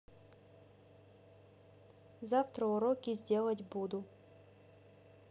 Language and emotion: Russian, neutral